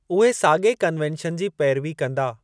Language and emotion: Sindhi, neutral